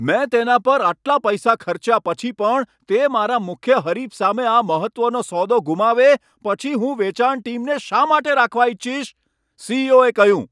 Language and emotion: Gujarati, angry